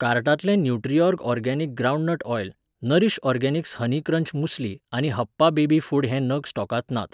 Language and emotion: Goan Konkani, neutral